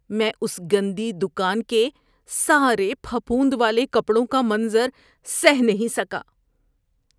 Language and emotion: Urdu, disgusted